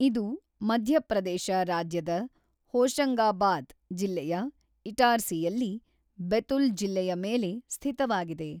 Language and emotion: Kannada, neutral